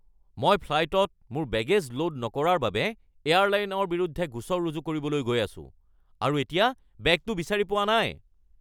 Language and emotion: Assamese, angry